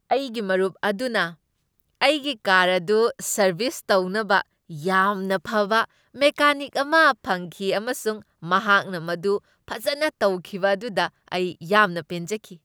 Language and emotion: Manipuri, happy